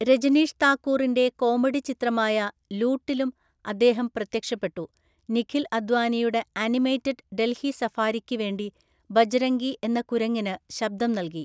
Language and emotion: Malayalam, neutral